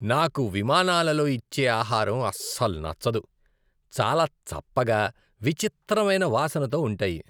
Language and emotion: Telugu, disgusted